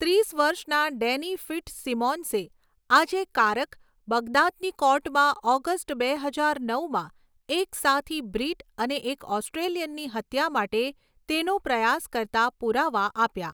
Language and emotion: Gujarati, neutral